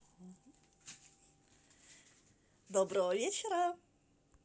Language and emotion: Russian, positive